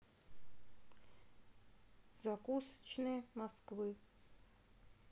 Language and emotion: Russian, neutral